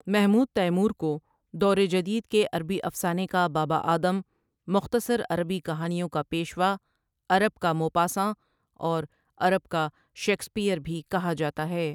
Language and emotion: Urdu, neutral